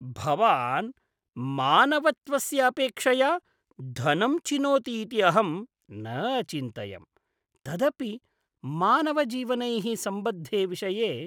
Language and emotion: Sanskrit, disgusted